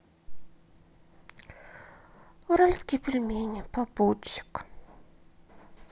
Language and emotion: Russian, sad